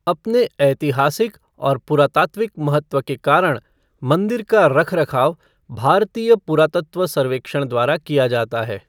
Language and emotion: Hindi, neutral